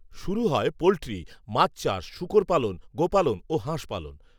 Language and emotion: Bengali, neutral